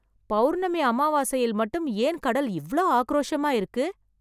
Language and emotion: Tamil, surprised